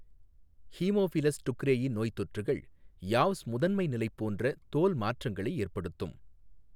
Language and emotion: Tamil, neutral